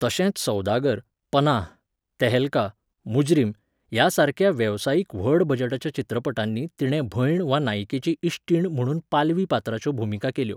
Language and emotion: Goan Konkani, neutral